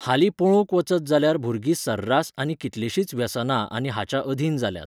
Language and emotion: Goan Konkani, neutral